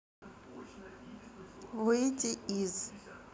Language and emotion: Russian, neutral